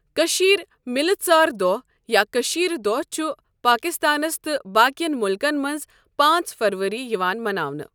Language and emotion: Kashmiri, neutral